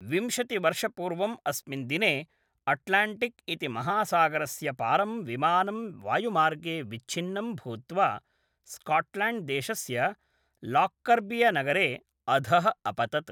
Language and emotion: Sanskrit, neutral